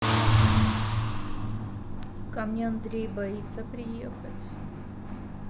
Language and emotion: Russian, sad